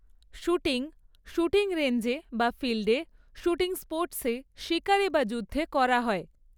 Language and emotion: Bengali, neutral